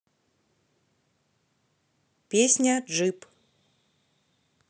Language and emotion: Russian, neutral